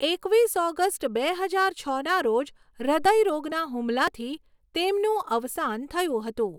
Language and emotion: Gujarati, neutral